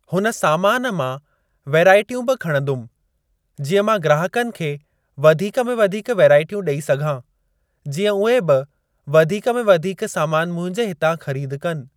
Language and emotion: Sindhi, neutral